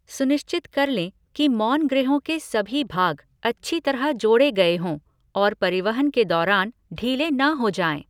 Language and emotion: Hindi, neutral